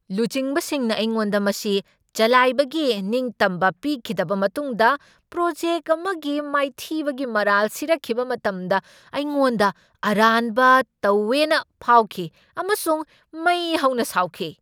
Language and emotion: Manipuri, angry